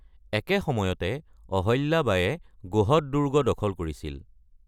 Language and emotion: Assamese, neutral